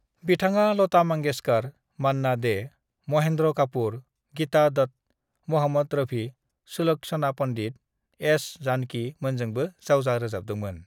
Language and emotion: Bodo, neutral